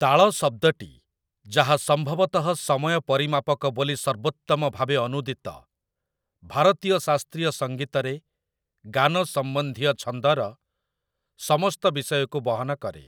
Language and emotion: Odia, neutral